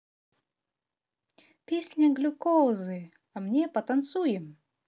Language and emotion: Russian, positive